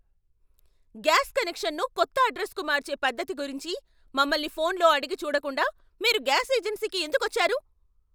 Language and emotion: Telugu, angry